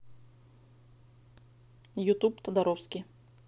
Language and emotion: Russian, neutral